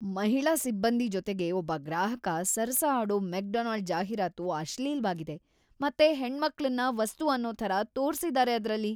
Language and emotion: Kannada, disgusted